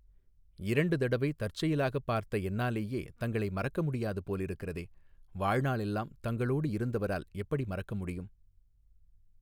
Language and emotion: Tamil, neutral